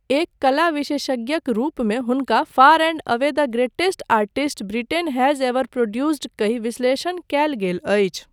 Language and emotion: Maithili, neutral